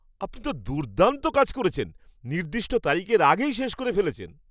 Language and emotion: Bengali, happy